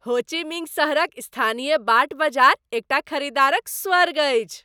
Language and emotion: Maithili, happy